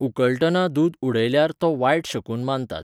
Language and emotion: Goan Konkani, neutral